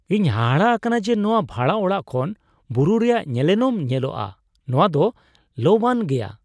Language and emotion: Santali, surprised